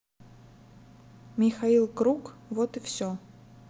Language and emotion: Russian, neutral